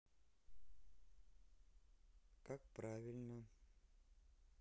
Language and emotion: Russian, neutral